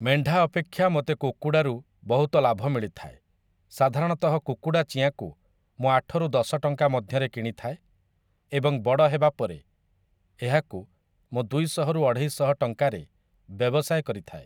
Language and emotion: Odia, neutral